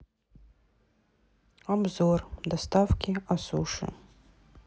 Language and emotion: Russian, sad